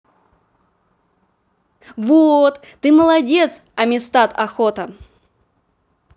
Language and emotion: Russian, positive